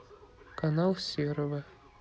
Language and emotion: Russian, neutral